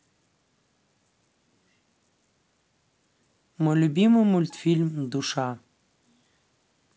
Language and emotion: Russian, neutral